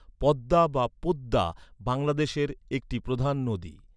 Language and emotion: Bengali, neutral